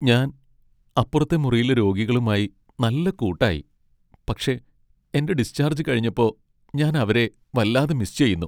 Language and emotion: Malayalam, sad